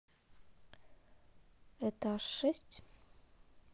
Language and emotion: Russian, neutral